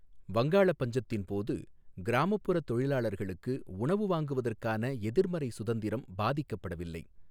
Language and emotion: Tamil, neutral